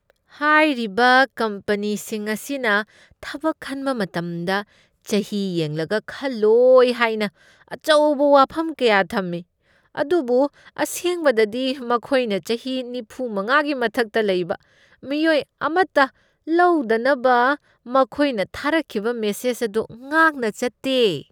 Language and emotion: Manipuri, disgusted